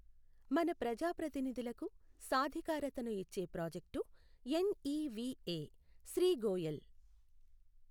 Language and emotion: Telugu, neutral